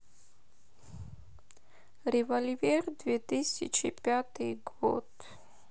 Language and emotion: Russian, sad